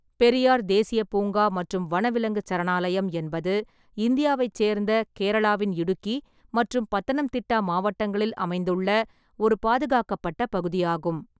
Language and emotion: Tamil, neutral